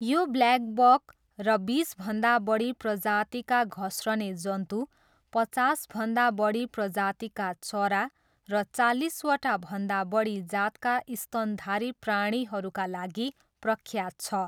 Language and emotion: Nepali, neutral